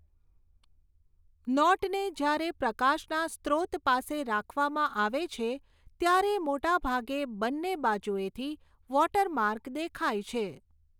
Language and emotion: Gujarati, neutral